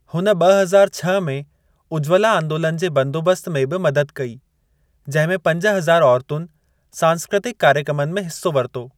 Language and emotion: Sindhi, neutral